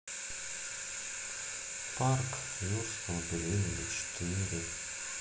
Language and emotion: Russian, sad